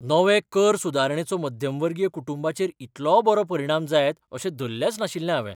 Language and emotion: Goan Konkani, surprised